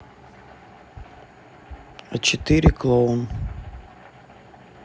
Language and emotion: Russian, neutral